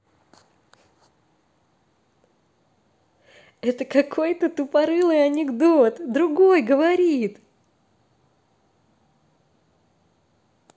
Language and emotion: Russian, positive